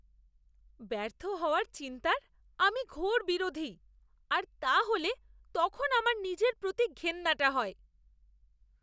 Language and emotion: Bengali, disgusted